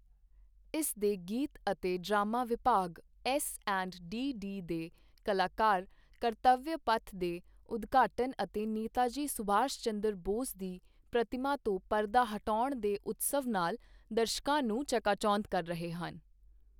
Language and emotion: Punjabi, neutral